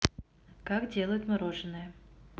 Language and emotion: Russian, neutral